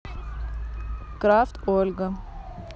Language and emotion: Russian, neutral